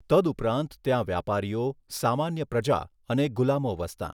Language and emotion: Gujarati, neutral